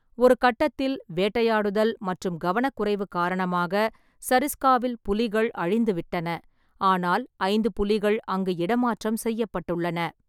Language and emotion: Tamil, neutral